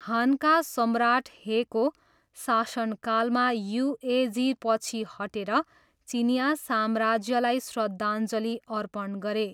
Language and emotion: Nepali, neutral